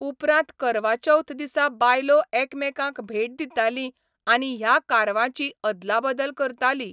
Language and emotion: Goan Konkani, neutral